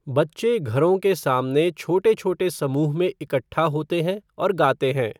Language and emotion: Hindi, neutral